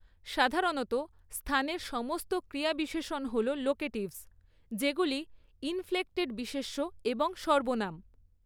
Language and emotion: Bengali, neutral